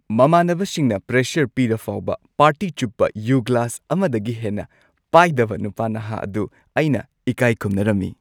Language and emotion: Manipuri, happy